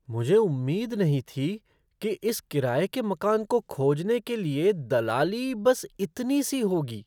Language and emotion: Hindi, surprised